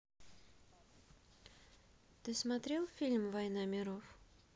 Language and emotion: Russian, neutral